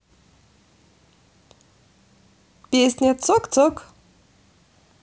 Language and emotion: Russian, positive